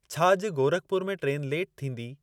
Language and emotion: Sindhi, neutral